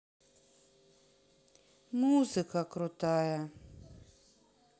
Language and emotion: Russian, sad